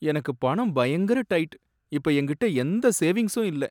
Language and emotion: Tamil, sad